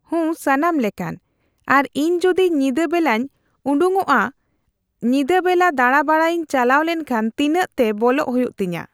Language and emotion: Santali, neutral